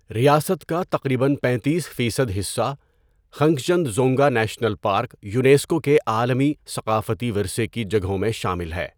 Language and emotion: Urdu, neutral